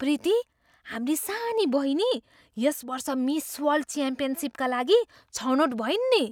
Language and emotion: Nepali, surprised